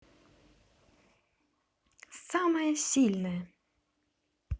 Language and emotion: Russian, positive